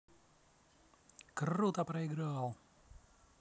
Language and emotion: Russian, positive